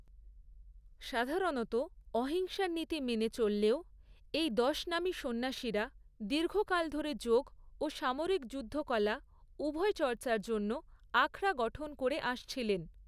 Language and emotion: Bengali, neutral